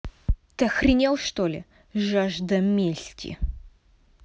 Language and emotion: Russian, angry